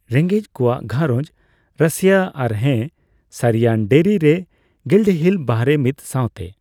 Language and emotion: Santali, neutral